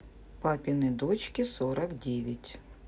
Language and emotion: Russian, neutral